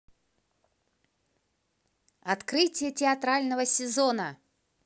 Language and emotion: Russian, positive